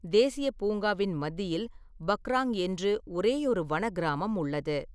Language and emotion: Tamil, neutral